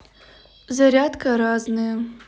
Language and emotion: Russian, neutral